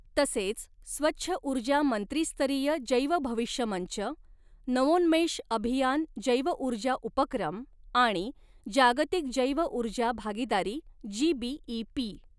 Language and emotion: Marathi, neutral